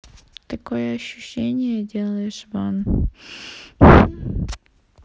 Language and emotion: Russian, sad